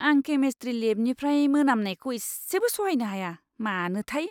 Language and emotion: Bodo, disgusted